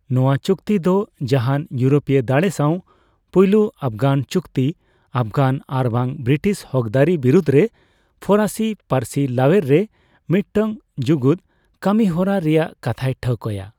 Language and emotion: Santali, neutral